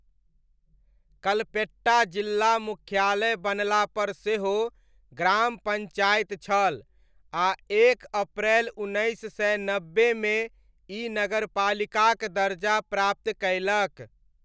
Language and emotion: Maithili, neutral